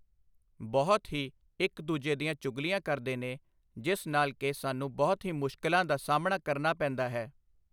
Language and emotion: Punjabi, neutral